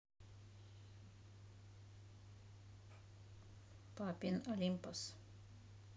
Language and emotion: Russian, neutral